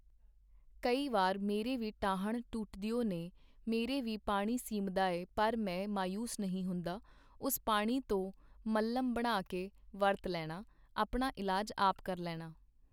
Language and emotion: Punjabi, neutral